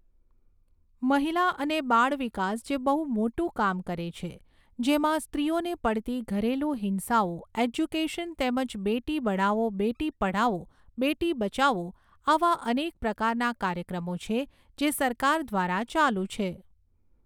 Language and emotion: Gujarati, neutral